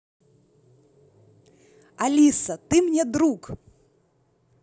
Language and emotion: Russian, positive